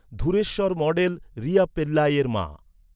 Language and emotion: Bengali, neutral